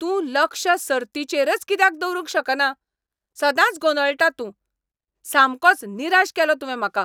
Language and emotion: Goan Konkani, angry